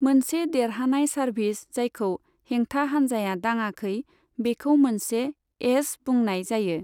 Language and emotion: Bodo, neutral